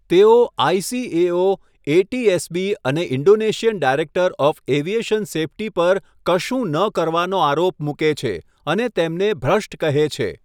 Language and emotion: Gujarati, neutral